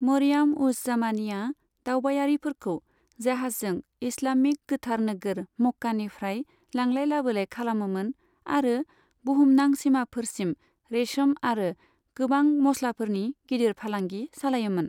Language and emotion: Bodo, neutral